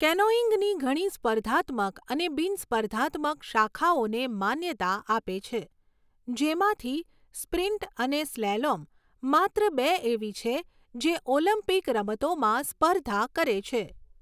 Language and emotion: Gujarati, neutral